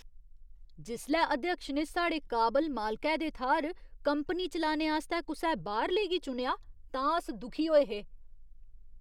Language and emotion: Dogri, disgusted